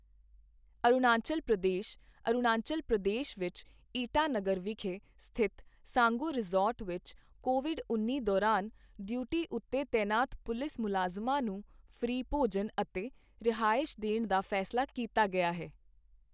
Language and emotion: Punjabi, neutral